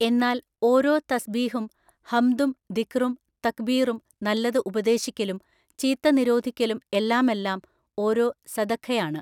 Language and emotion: Malayalam, neutral